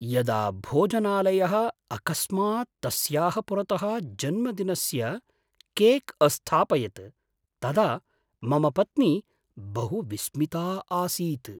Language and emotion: Sanskrit, surprised